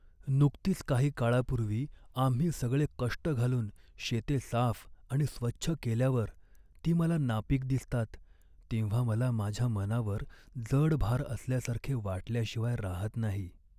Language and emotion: Marathi, sad